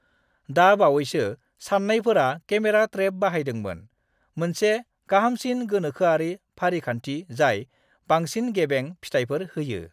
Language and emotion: Bodo, neutral